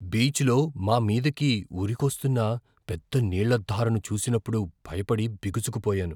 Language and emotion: Telugu, fearful